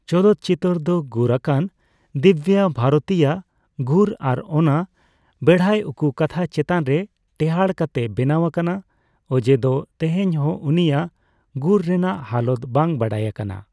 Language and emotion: Santali, neutral